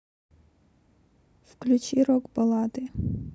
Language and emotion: Russian, neutral